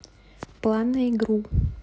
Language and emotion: Russian, neutral